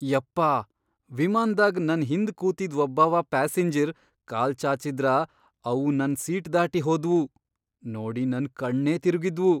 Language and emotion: Kannada, surprised